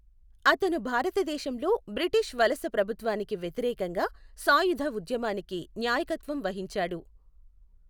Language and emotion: Telugu, neutral